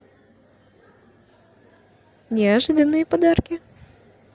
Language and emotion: Russian, positive